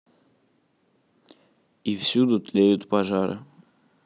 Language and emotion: Russian, neutral